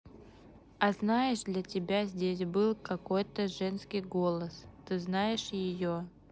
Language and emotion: Russian, neutral